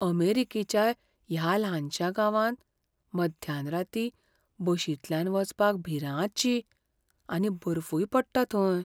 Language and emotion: Goan Konkani, fearful